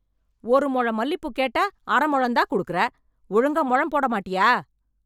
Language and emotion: Tamil, angry